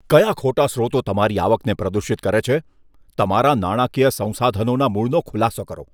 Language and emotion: Gujarati, disgusted